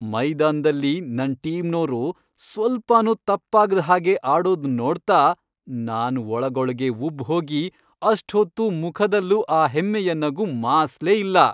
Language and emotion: Kannada, happy